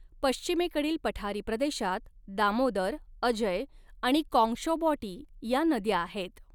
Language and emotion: Marathi, neutral